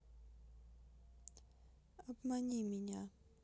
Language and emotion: Russian, sad